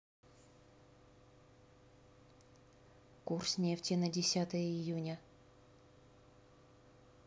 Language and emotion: Russian, neutral